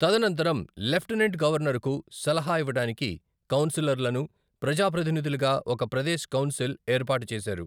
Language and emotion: Telugu, neutral